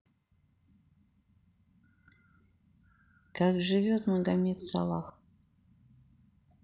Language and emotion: Russian, neutral